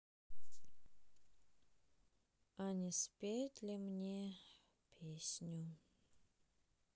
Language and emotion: Russian, sad